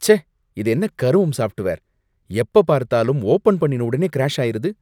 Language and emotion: Tamil, disgusted